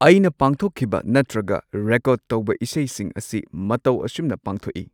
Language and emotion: Manipuri, neutral